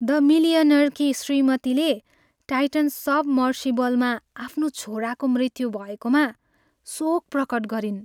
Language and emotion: Nepali, sad